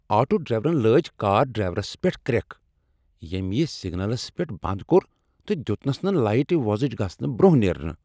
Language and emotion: Kashmiri, angry